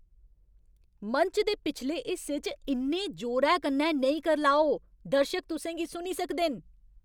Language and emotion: Dogri, angry